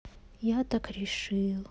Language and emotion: Russian, sad